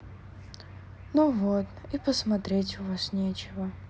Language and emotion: Russian, sad